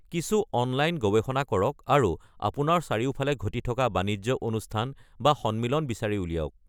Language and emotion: Assamese, neutral